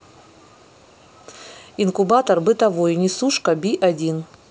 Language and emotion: Russian, neutral